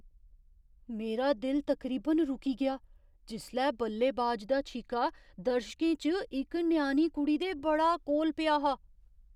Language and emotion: Dogri, surprised